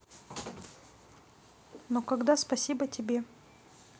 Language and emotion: Russian, neutral